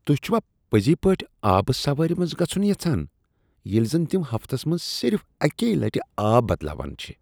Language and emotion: Kashmiri, disgusted